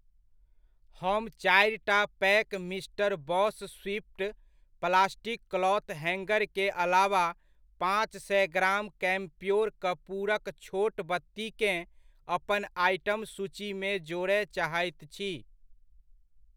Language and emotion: Maithili, neutral